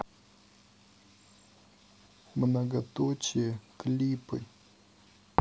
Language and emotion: Russian, neutral